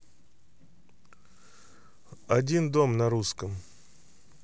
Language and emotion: Russian, neutral